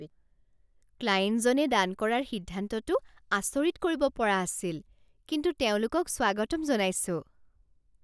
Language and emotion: Assamese, surprised